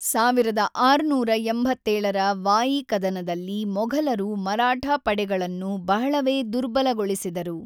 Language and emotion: Kannada, neutral